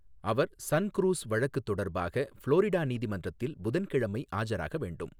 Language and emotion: Tamil, neutral